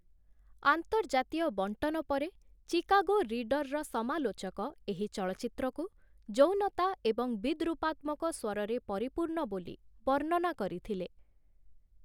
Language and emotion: Odia, neutral